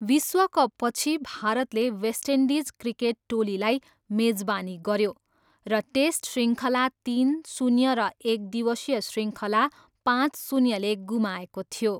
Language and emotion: Nepali, neutral